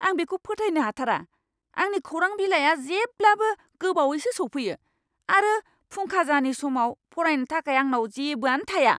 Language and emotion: Bodo, angry